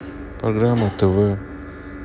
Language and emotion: Russian, sad